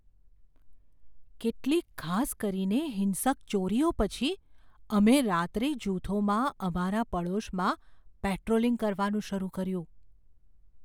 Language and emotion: Gujarati, fearful